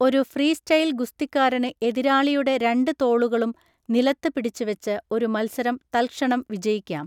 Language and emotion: Malayalam, neutral